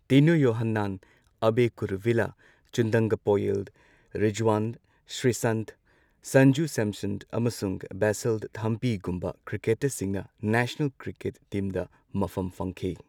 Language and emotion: Manipuri, neutral